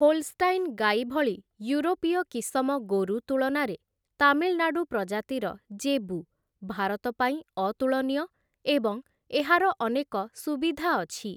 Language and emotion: Odia, neutral